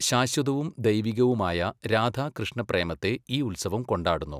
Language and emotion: Malayalam, neutral